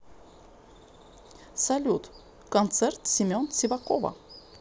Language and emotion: Russian, neutral